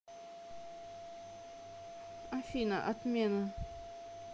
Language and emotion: Russian, neutral